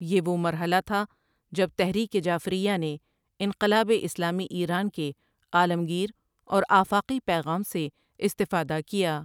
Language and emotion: Urdu, neutral